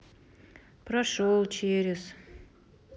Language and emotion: Russian, neutral